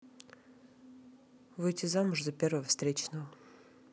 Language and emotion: Russian, neutral